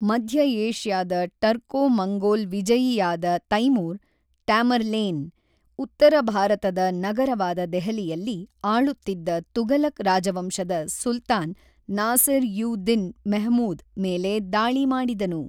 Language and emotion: Kannada, neutral